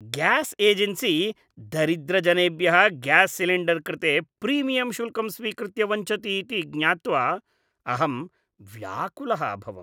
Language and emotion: Sanskrit, disgusted